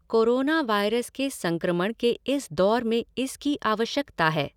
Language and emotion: Hindi, neutral